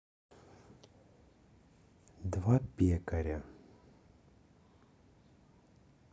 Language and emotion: Russian, neutral